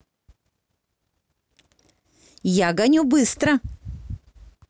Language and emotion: Russian, positive